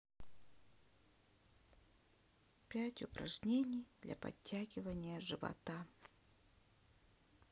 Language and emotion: Russian, sad